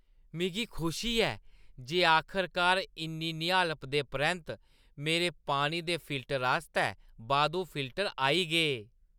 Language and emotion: Dogri, happy